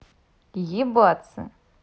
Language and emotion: Russian, neutral